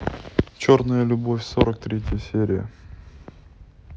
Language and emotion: Russian, neutral